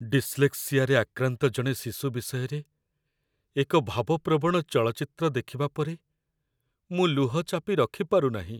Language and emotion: Odia, sad